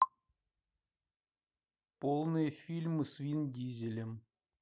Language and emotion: Russian, neutral